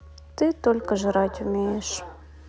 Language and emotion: Russian, sad